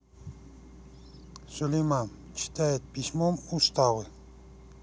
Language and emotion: Russian, neutral